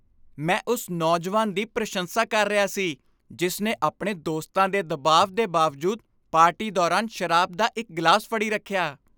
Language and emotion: Punjabi, happy